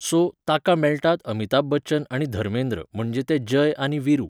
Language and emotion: Goan Konkani, neutral